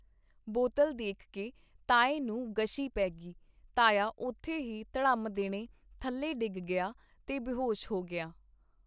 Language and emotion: Punjabi, neutral